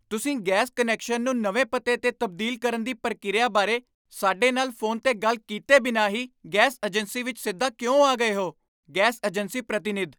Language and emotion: Punjabi, angry